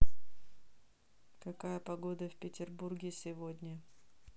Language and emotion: Russian, neutral